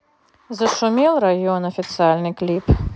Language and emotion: Russian, neutral